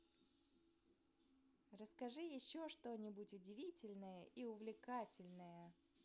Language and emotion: Russian, neutral